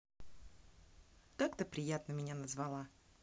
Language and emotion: Russian, positive